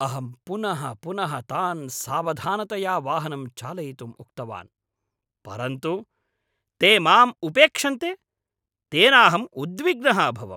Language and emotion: Sanskrit, angry